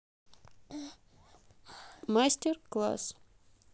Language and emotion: Russian, neutral